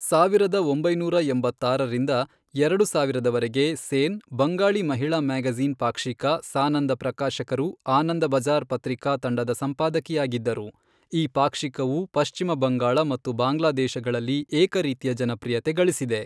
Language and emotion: Kannada, neutral